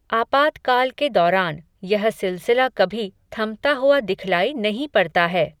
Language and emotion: Hindi, neutral